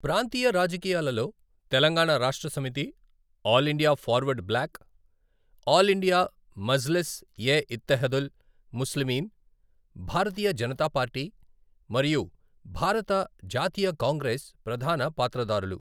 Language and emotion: Telugu, neutral